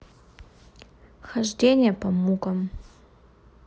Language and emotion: Russian, neutral